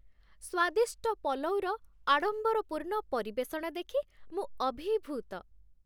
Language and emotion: Odia, happy